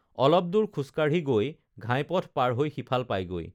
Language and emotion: Assamese, neutral